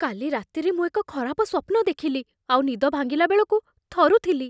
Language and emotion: Odia, fearful